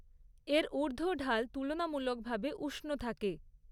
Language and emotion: Bengali, neutral